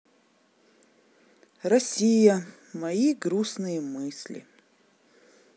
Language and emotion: Russian, sad